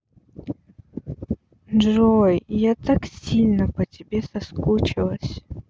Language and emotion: Russian, sad